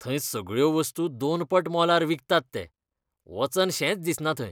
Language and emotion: Goan Konkani, disgusted